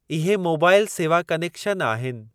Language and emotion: Sindhi, neutral